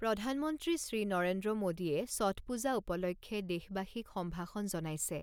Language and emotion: Assamese, neutral